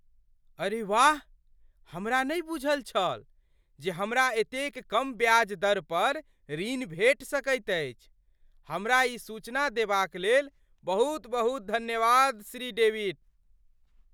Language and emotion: Maithili, surprised